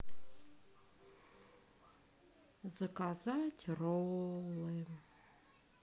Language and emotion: Russian, sad